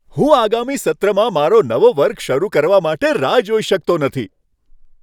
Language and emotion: Gujarati, happy